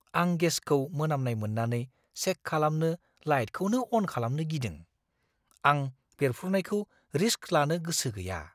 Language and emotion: Bodo, fearful